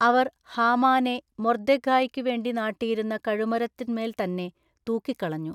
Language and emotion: Malayalam, neutral